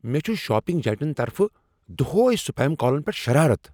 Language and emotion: Kashmiri, angry